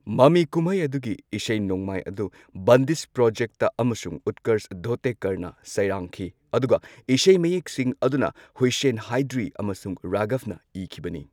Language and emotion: Manipuri, neutral